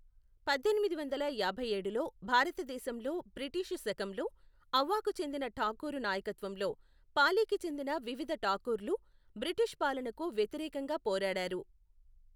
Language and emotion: Telugu, neutral